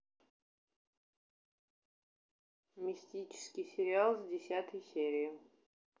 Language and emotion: Russian, neutral